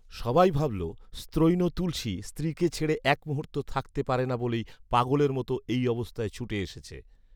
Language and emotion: Bengali, neutral